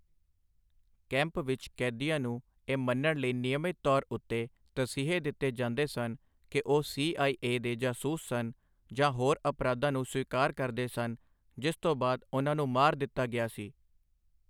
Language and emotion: Punjabi, neutral